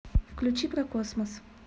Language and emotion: Russian, neutral